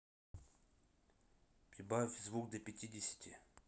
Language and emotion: Russian, neutral